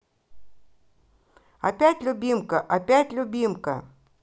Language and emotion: Russian, positive